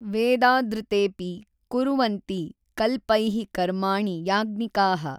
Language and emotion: Kannada, neutral